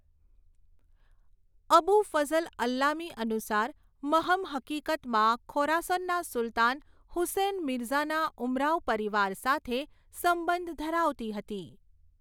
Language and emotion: Gujarati, neutral